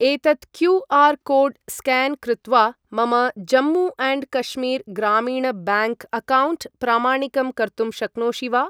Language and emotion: Sanskrit, neutral